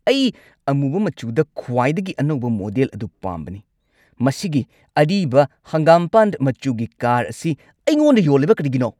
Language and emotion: Manipuri, angry